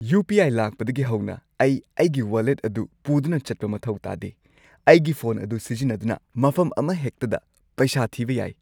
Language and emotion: Manipuri, happy